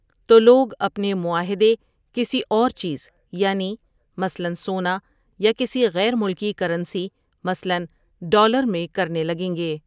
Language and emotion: Urdu, neutral